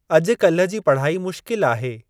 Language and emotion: Sindhi, neutral